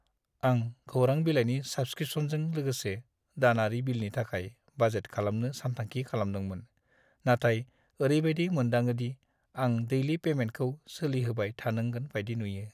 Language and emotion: Bodo, sad